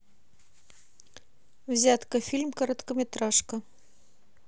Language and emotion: Russian, neutral